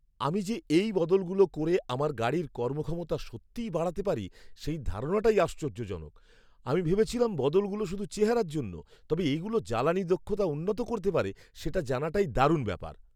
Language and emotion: Bengali, surprised